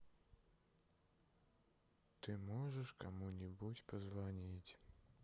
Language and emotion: Russian, sad